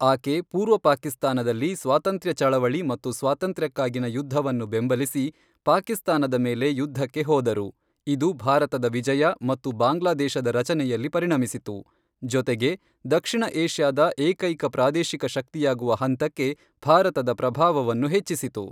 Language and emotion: Kannada, neutral